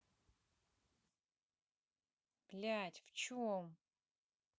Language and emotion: Russian, angry